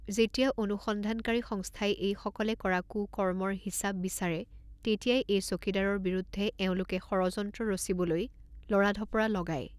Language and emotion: Assamese, neutral